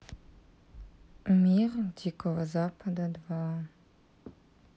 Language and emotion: Russian, neutral